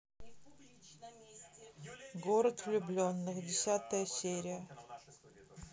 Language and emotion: Russian, neutral